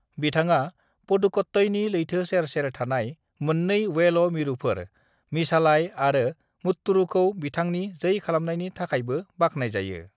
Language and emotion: Bodo, neutral